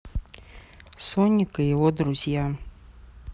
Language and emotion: Russian, neutral